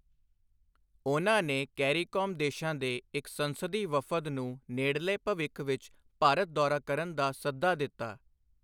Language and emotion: Punjabi, neutral